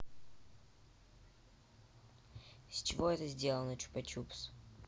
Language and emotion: Russian, neutral